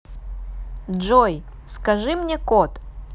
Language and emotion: Russian, neutral